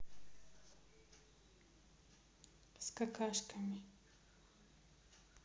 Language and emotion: Russian, neutral